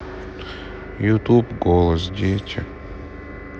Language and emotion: Russian, sad